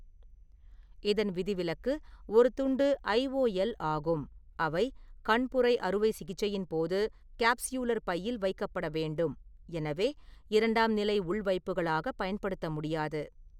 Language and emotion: Tamil, neutral